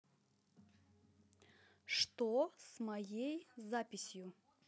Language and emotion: Russian, neutral